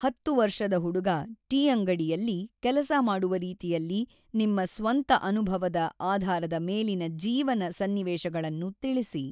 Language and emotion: Kannada, neutral